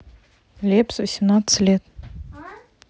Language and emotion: Russian, neutral